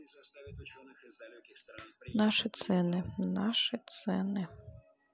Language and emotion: Russian, neutral